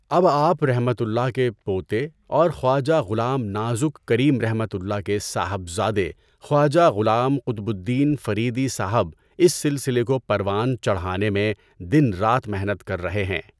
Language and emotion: Urdu, neutral